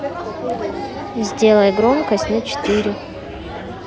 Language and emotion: Russian, neutral